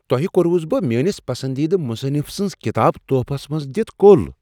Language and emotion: Kashmiri, surprised